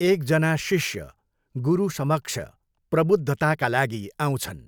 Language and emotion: Nepali, neutral